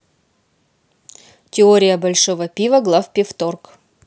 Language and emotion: Russian, neutral